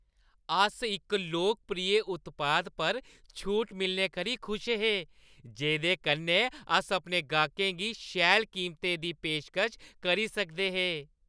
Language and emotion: Dogri, happy